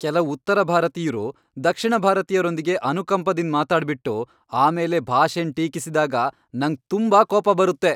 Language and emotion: Kannada, angry